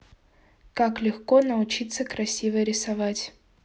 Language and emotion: Russian, neutral